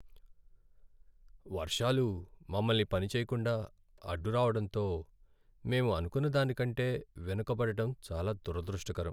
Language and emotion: Telugu, sad